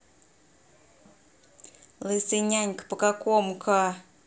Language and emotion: Russian, neutral